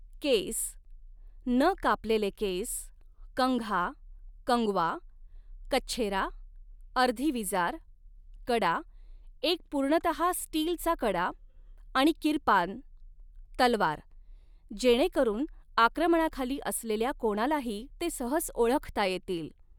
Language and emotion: Marathi, neutral